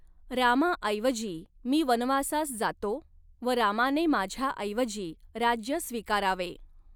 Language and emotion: Marathi, neutral